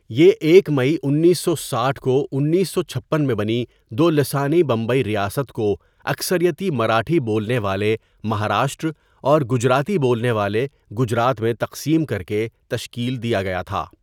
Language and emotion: Urdu, neutral